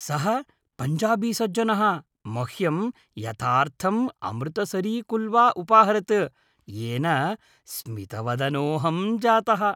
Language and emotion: Sanskrit, happy